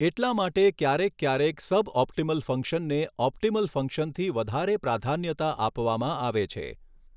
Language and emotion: Gujarati, neutral